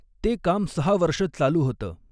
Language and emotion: Marathi, neutral